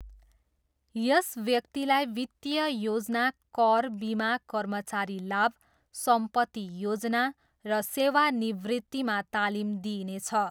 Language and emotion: Nepali, neutral